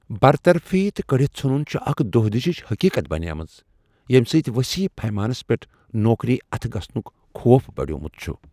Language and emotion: Kashmiri, fearful